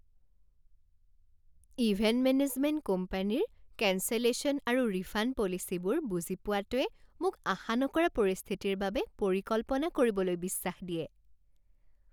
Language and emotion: Assamese, happy